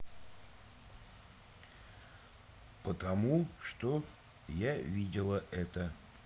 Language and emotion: Russian, neutral